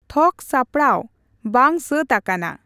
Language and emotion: Santali, neutral